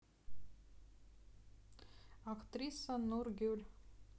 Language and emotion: Russian, neutral